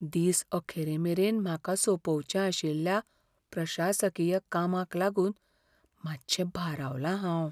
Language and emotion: Goan Konkani, fearful